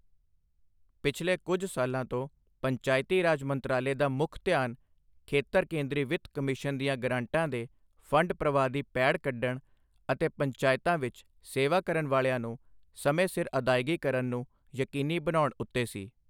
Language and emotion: Punjabi, neutral